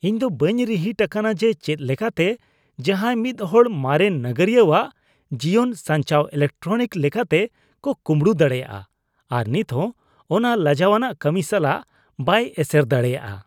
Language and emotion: Santali, disgusted